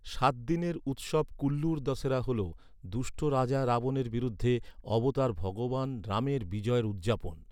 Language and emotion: Bengali, neutral